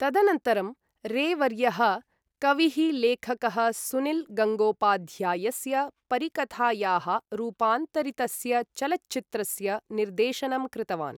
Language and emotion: Sanskrit, neutral